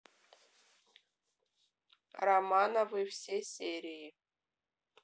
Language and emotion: Russian, neutral